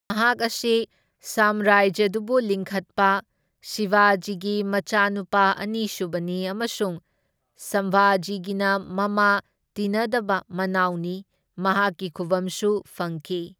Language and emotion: Manipuri, neutral